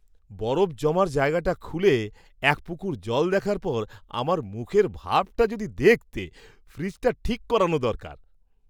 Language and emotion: Bengali, surprised